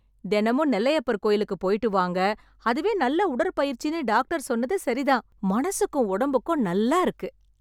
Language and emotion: Tamil, happy